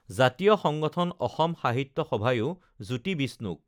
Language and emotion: Assamese, neutral